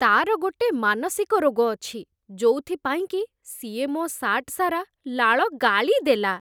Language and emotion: Odia, disgusted